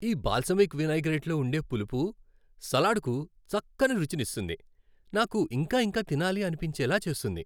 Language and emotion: Telugu, happy